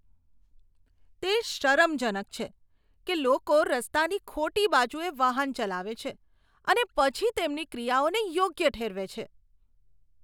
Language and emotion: Gujarati, disgusted